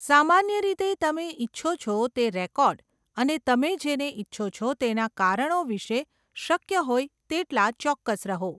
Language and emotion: Gujarati, neutral